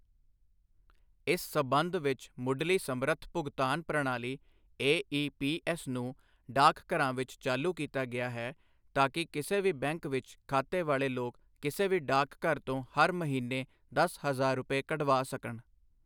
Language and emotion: Punjabi, neutral